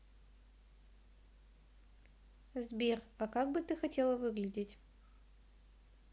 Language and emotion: Russian, neutral